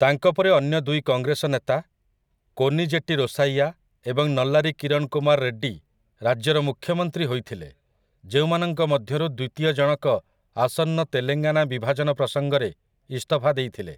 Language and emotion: Odia, neutral